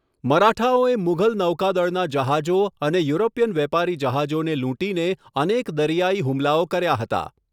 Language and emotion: Gujarati, neutral